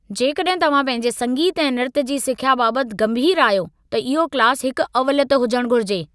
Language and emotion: Sindhi, angry